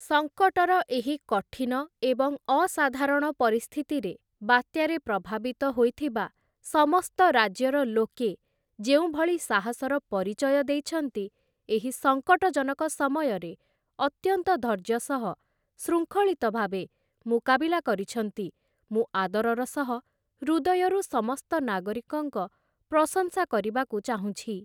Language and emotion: Odia, neutral